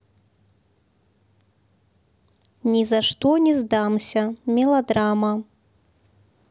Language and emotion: Russian, neutral